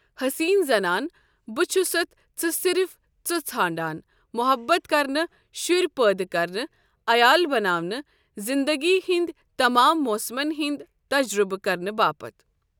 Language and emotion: Kashmiri, neutral